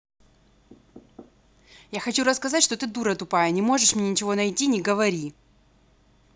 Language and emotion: Russian, angry